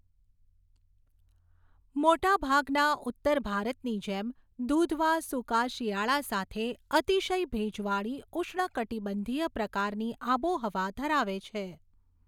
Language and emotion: Gujarati, neutral